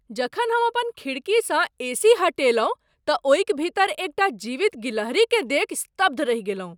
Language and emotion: Maithili, surprised